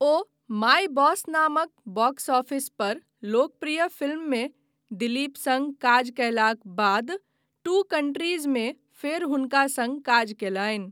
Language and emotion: Maithili, neutral